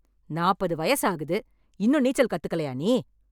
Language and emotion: Tamil, angry